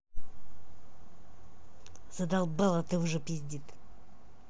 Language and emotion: Russian, angry